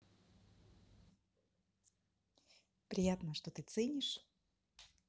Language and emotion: Russian, positive